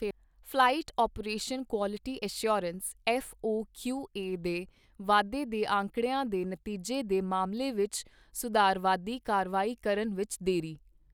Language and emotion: Punjabi, neutral